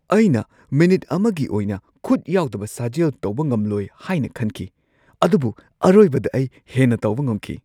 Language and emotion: Manipuri, surprised